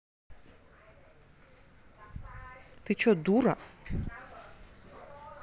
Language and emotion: Russian, angry